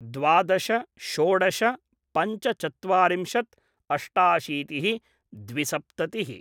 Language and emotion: Sanskrit, neutral